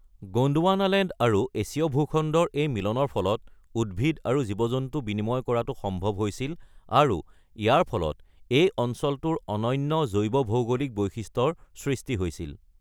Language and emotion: Assamese, neutral